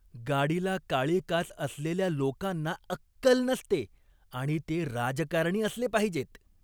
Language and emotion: Marathi, disgusted